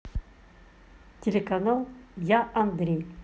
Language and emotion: Russian, neutral